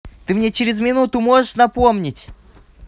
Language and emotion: Russian, angry